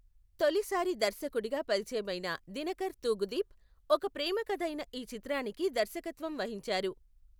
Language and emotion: Telugu, neutral